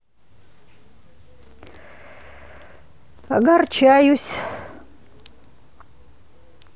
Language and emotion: Russian, sad